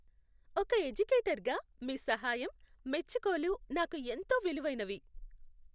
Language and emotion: Telugu, happy